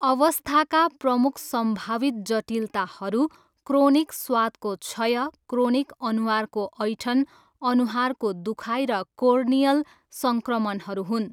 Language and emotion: Nepali, neutral